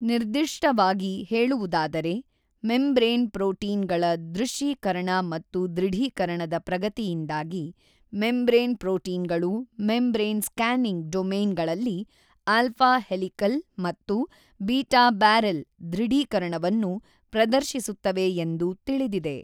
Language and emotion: Kannada, neutral